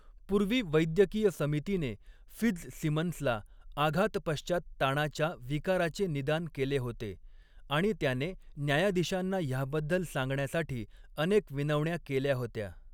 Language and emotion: Marathi, neutral